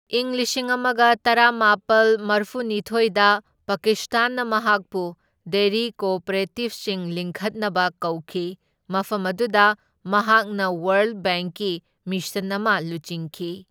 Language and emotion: Manipuri, neutral